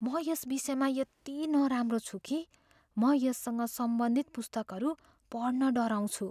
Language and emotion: Nepali, fearful